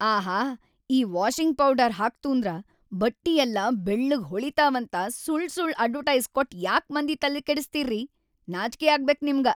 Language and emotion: Kannada, angry